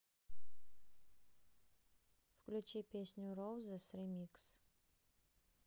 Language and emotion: Russian, neutral